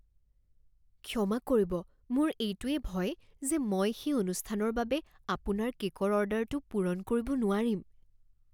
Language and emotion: Assamese, fearful